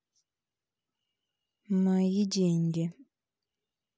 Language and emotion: Russian, neutral